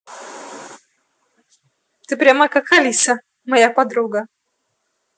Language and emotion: Russian, neutral